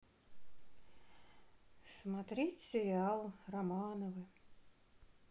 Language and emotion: Russian, neutral